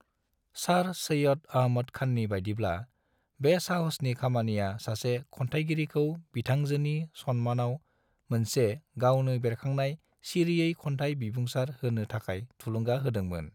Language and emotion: Bodo, neutral